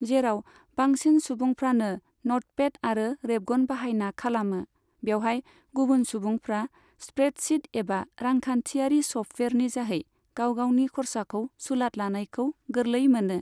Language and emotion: Bodo, neutral